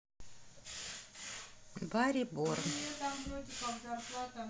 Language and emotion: Russian, neutral